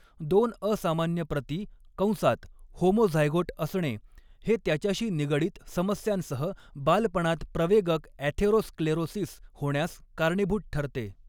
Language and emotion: Marathi, neutral